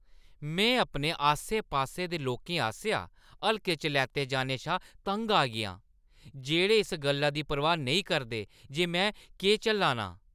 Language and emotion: Dogri, angry